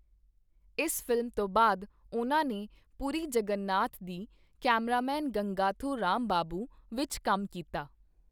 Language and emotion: Punjabi, neutral